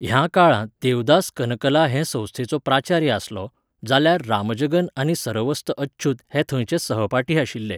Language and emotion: Goan Konkani, neutral